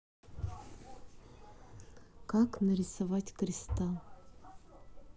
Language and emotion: Russian, neutral